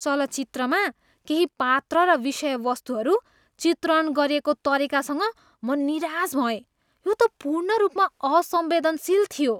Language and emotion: Nepali, disgusted